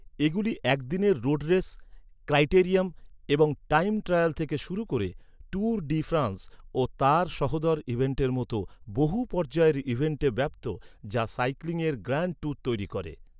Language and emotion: Bengali, neutral